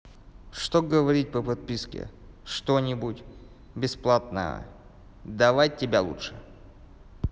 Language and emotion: Russian, neutral